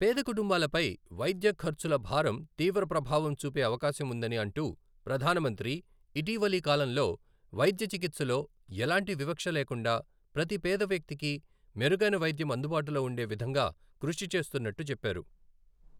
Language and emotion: Telugu, neutral